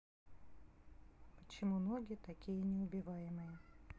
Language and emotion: Russian, neutral